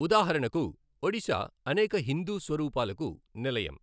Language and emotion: Telugu, neutral